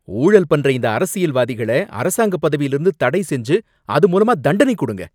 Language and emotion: Tamil, angry